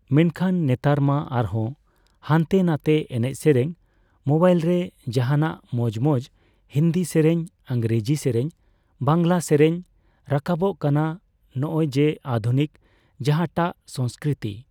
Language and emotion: Santali, neutral